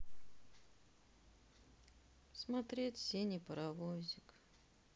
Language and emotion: Russian, sad